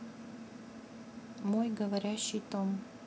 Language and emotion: Russian, neutral